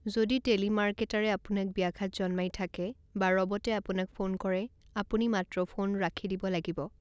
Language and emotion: Assamese, neutral